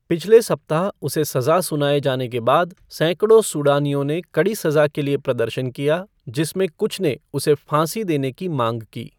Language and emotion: Hindi, neutral